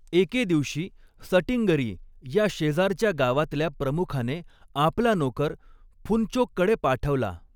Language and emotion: Marathi, neutral